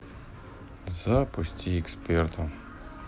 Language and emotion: Russian, sad